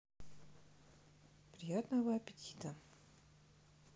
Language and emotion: Russian, neutral